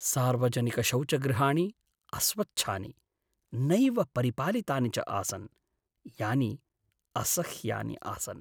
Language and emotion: Sanskrit, sad